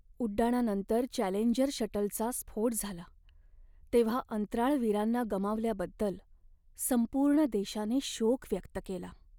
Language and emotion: Marathi, sad